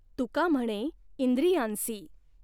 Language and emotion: Marathi, neutral